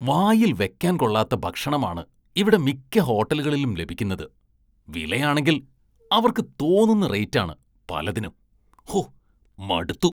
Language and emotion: Malayalam, disgusted